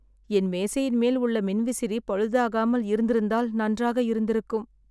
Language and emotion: Tamil, sad